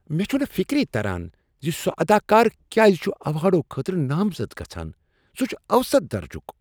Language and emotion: Kashmiri, disgusted